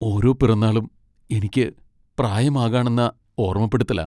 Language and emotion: Malayalam, sad